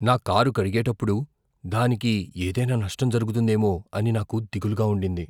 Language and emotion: Telugu, fearful